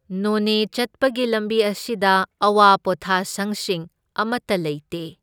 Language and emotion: Manipuri, neutral